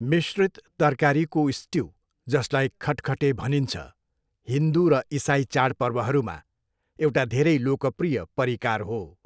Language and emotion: Nepali, neutral